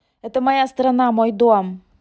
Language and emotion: Russian, angry